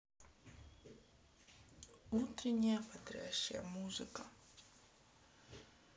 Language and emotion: Russian, sad